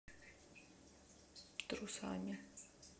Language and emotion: Russian, neutral